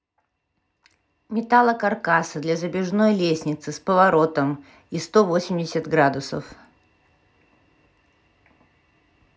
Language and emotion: Russian, neutral